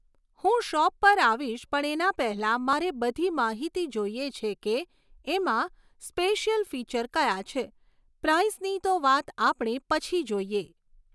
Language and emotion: Gujarati, neutral